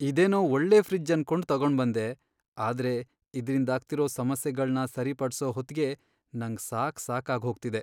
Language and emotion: Kannada, sad